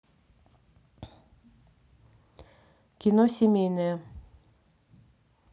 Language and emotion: Russian, neutral